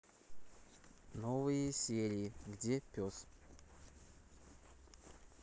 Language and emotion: Russian, neutral